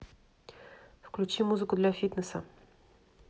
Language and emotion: Russian, neutral